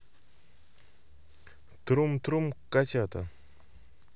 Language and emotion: Russian, neutral